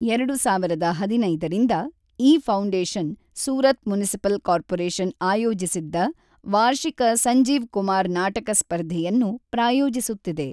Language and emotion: Kannada, neutral